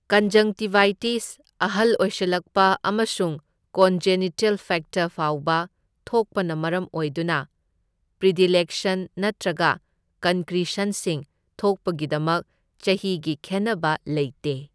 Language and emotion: Manipuri, neutral